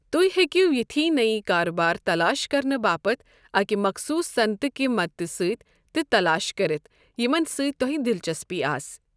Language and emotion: Kashmiri, neutral